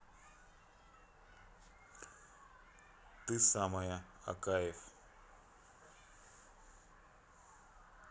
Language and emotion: Russian, neutral